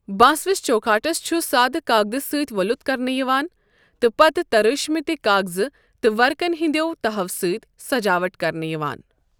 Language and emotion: Kashmiri, neutral